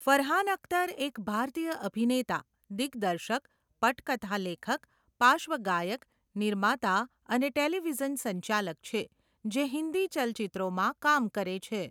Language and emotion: Gujarati, neutral